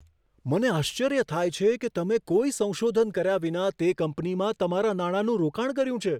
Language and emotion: Gujarati, surprised